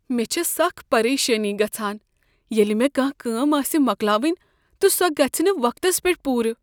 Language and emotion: Kashmiri, fearful